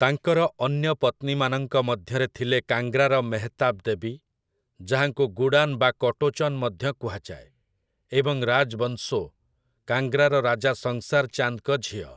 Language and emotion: Odia, neutral